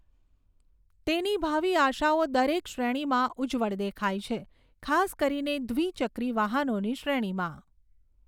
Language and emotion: Gujarati, neutral